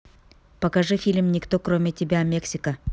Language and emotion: Russian, neutral